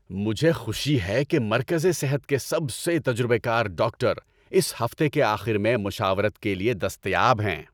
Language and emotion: Urdu, happy